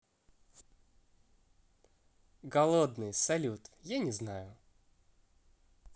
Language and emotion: Russian, positive